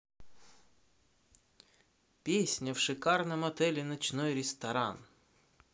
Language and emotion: Russian, positive